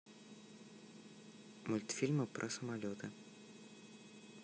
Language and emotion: Russian, neutral